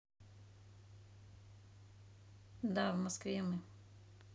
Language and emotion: Russian, neutral